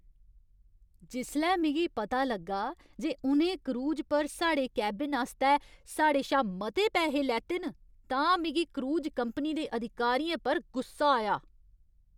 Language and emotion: Dogri, angry